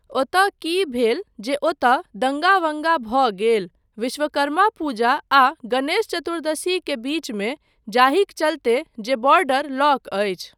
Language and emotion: Maithili, neutral